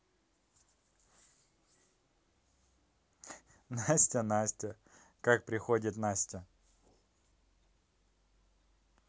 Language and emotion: Russian, positive